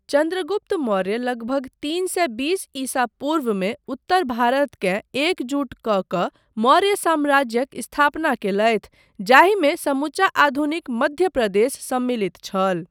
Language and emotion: Maithili, neutral